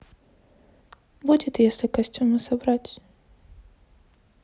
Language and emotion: Russian, sad